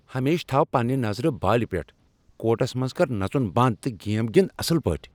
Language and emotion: Kashmiri, angry